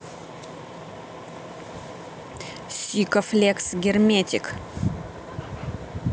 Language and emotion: Russian, neutral